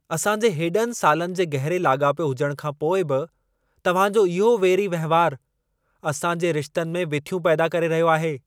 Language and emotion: Sindhi, angry